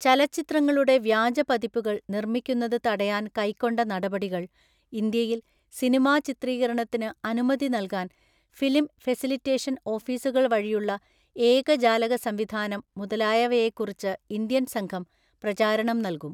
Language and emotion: Malayalam, neutral